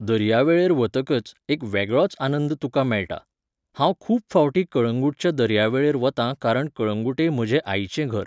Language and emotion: Goan Konkani, neutral